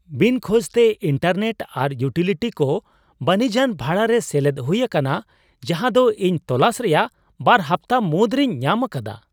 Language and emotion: Santali, surprised